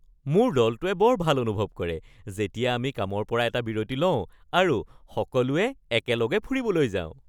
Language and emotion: Assamese, happy